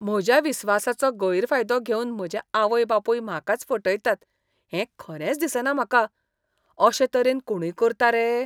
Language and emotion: Goan Konkani, disgusted